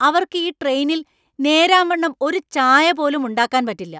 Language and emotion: Malayalam, angry